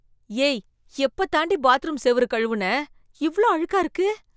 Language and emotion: Tamil, disgusted